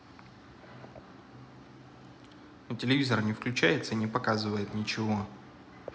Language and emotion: Russian, neutral